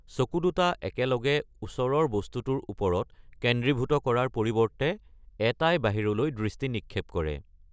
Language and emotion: Assamese, neutral